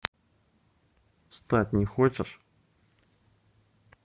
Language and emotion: Russian, neutral